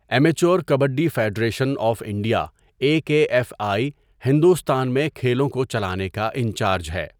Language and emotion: Urdu, neutral